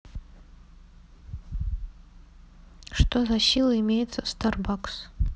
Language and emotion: Russian, neutral